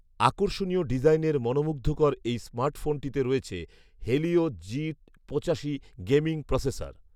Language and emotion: Bengali, neutral